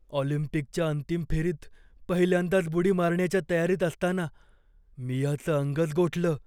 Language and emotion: Marathi, fearful